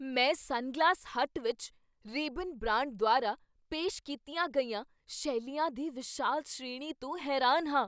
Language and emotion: Punjabi, surprised